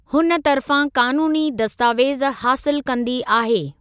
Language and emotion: Sindhi, neutral